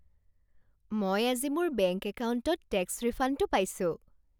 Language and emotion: Assamese, happy